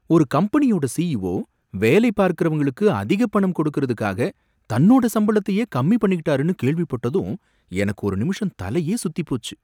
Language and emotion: Tamil, surprised